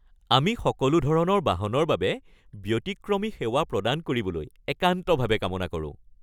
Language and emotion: Assamese, happy